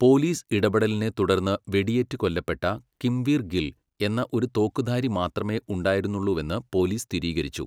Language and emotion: Malayalam, neutral